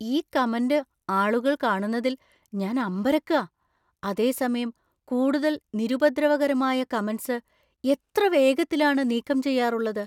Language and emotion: Malayalam, surprised